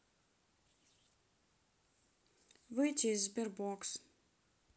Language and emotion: Russian, neutral